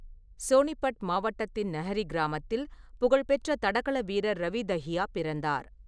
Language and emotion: Tamil, neutral